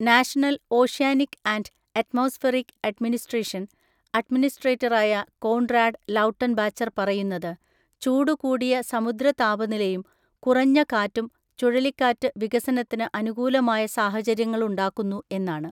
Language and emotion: Malayalam, neutral